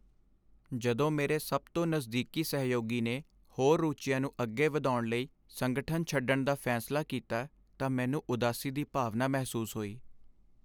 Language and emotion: Punjabi, sad